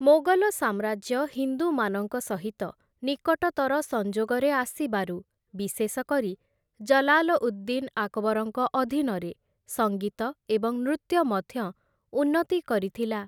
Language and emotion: Odia, neutral